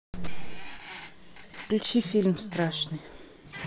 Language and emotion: Russian, neutral